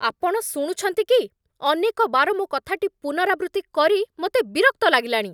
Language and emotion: Odia, angry